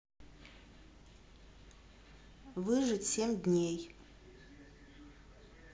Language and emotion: Russian, neutral